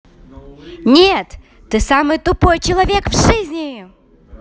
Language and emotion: Russian, angry